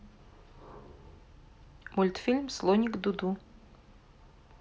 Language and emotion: Russian, neutral